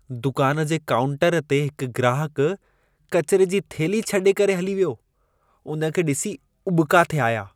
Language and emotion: Sindhi, disgusted